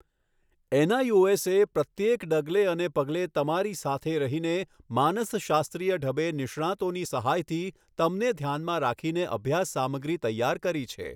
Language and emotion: Gujarati, neutral